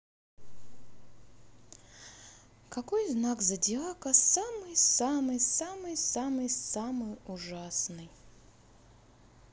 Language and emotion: Russian, sad